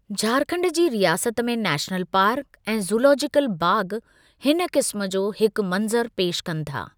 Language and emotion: Sindhi, neutral